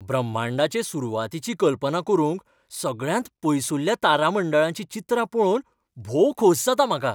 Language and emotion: Goan Konkani, happy